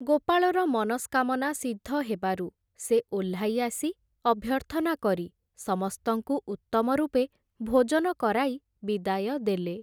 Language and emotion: Odia, neutral